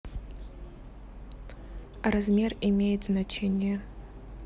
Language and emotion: Russian, neutral